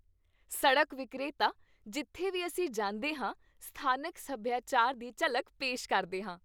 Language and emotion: Punjabi, happy